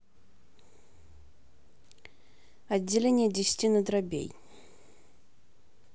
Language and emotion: Russian, neutral